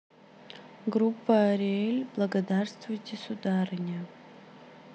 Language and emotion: Russian, neutral